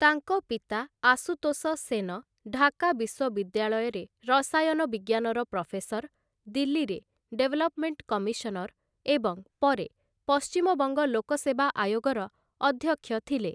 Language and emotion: Odia, neutral